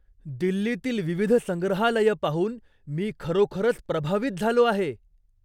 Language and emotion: Marathi, surprised